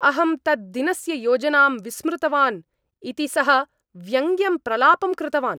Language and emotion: Sanskrit, angry